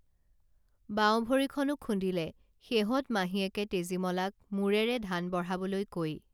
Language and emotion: Assamese, neutral